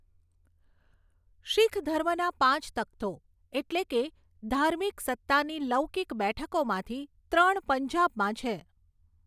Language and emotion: Gujarati, neutral